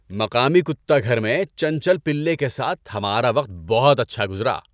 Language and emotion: Urdu, happy